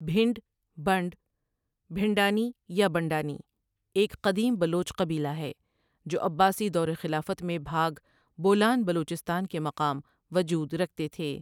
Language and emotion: Urdu, neutral